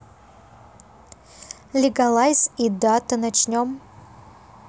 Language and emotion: Russian, neutral